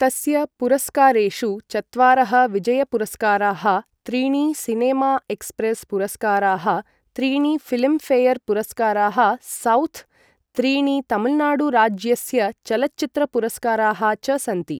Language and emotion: Sanskrit, neutral